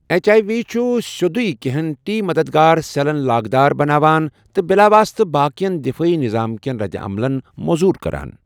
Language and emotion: Kashmiri, neutral